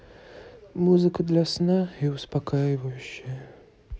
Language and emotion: Russian, sad